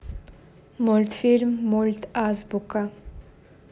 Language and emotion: Russian, neutral